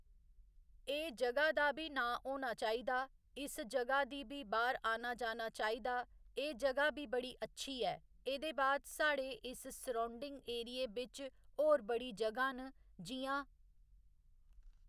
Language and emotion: Dogri, neutral